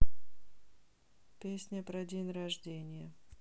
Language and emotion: Russian, sad